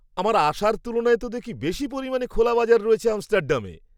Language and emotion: Bengali, surprised